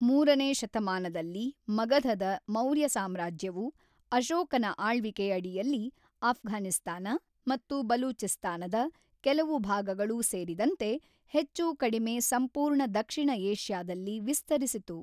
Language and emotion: Kannada, neutral